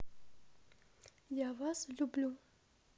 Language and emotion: Russian, neutral